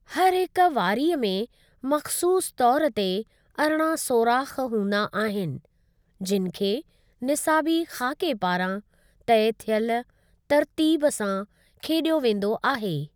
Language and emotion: Sindhi, neutral